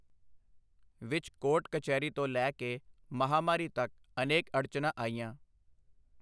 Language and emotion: Punjabi, neutral